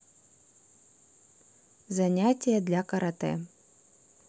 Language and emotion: Russian, neutral